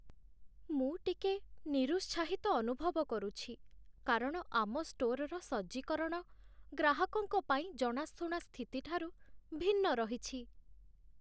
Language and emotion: Odia, sad